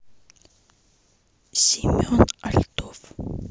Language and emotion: Russian, neutral